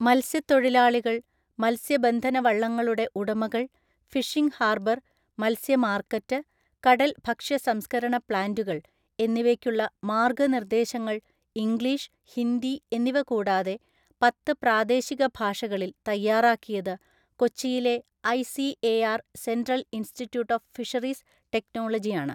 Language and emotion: Malayalam, neutral